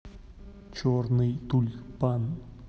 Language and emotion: Russian, neutral